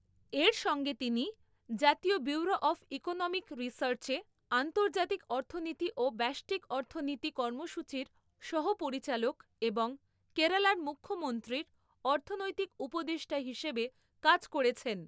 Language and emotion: Bengali, neutral